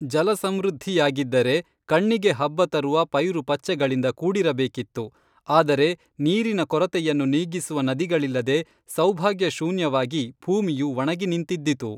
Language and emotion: Kannada, neutral